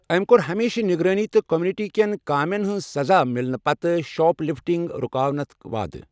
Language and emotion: Kashmiri, neutral